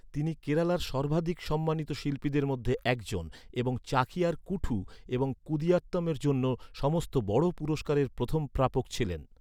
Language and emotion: Bengali, neutral